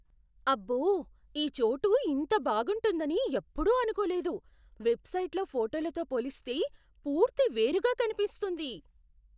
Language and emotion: Telugu, surprised